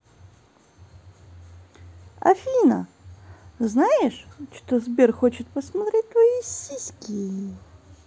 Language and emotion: Russian, positive